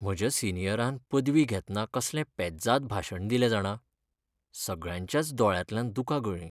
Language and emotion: Goan Konkani, sad